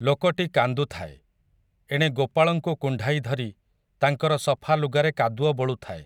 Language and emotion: Odia, neutral